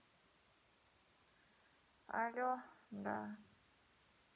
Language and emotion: Russian, sad